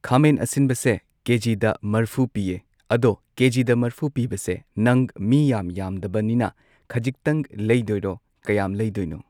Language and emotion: Manipuri, neutral